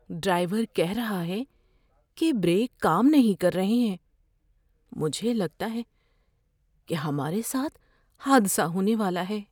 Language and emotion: Urdu, fearful